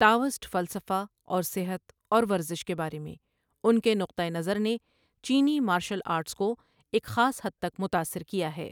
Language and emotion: Urdu, neutral